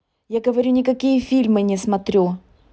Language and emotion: Russian, angry